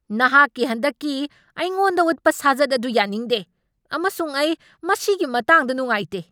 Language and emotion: Manipuri, angry